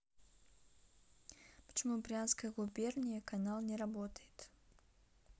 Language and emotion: Russian, neutral